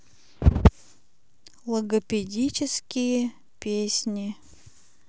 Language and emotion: Russian, neutral